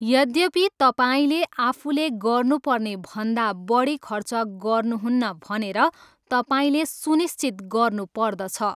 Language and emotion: Nepali, neutral